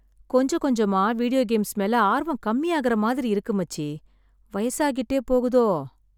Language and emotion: Tamil, sad